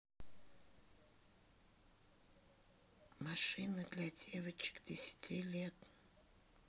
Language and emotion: Russian, neutral